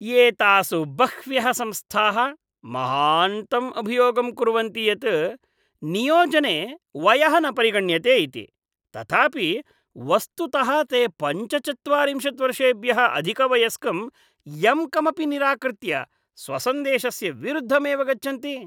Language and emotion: Sanskrit, disgusted